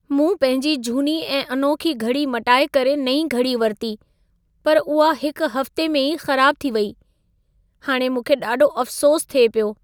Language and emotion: Sindhi, sad